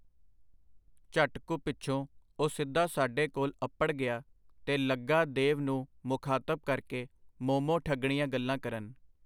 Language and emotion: Punjabi, neutral